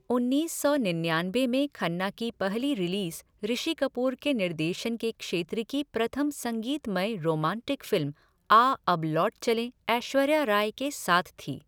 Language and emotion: Hindi, neutral